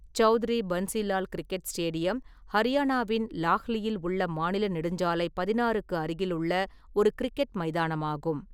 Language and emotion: Tamil, neutral